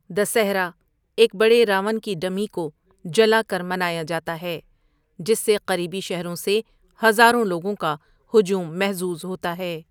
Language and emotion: Urdu, neutral